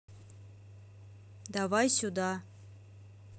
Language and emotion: Russian, neutral